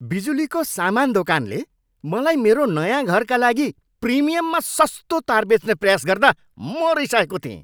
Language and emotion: Nepali, angry